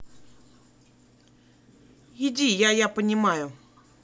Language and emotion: Russian, neutral